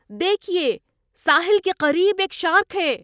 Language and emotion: Urdu, surprised